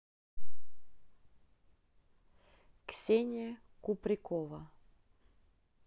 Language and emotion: Russian, neutral